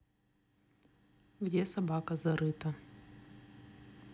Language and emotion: Russian, neutral